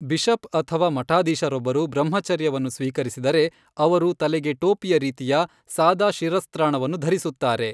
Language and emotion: Kannada, neutral